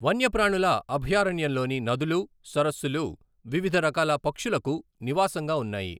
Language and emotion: Telugu, neutral